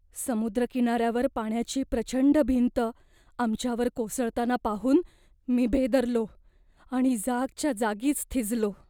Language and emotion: Marathi, fearful